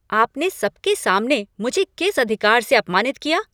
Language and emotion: Hindi, angry